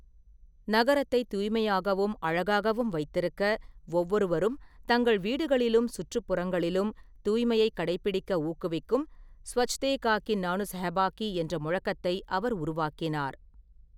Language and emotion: Tamil, neutral